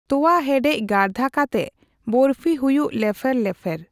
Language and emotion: Santali, neutral